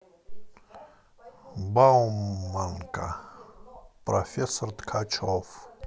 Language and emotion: Russian, neutral